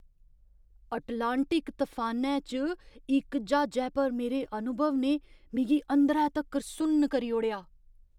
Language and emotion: Dogri, surprised